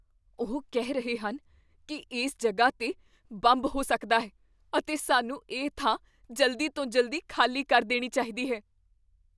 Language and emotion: Punjabi, fearful